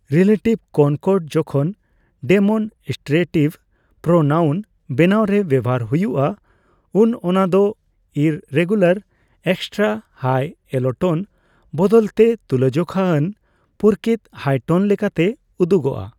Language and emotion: Santali, neutral